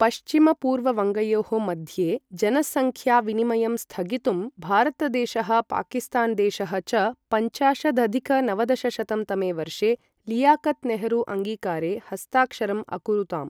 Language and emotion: Sanskrit, neutral